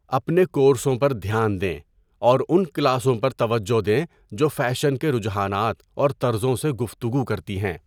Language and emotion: Urdu, neutral